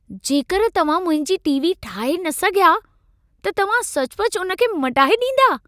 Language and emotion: Sindhi, surprised